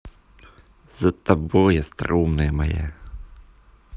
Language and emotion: Russian, positive